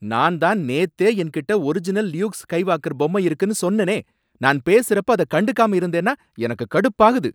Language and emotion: Tamil, angry